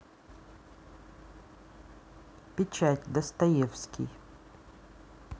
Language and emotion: Russian, neutral